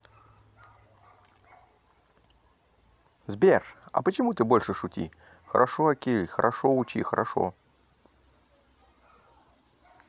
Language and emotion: Russian, positive